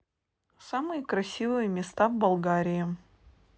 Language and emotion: Russian, neutral